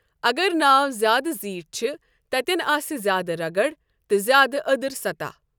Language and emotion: Kashmiri, neutral